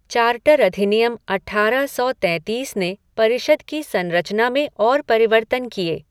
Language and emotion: Hindi, neutral